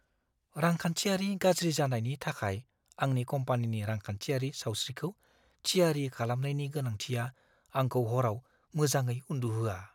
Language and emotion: Bodo, fearful